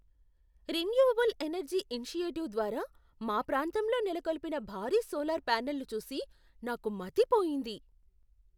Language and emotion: Telugu, surprised